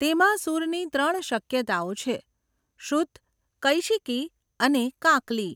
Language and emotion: Gujarati, neutral